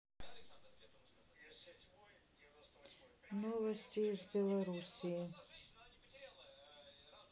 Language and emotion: Russian, sad